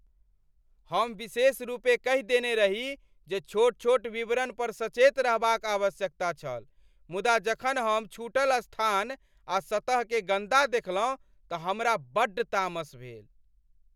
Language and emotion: Maithili, angry